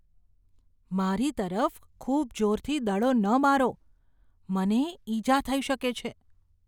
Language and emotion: Gujarati, fearful